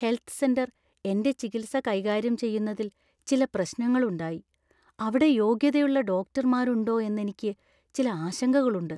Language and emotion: Malayalam, fearful